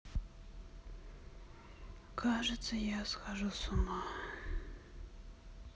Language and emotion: Russian, sad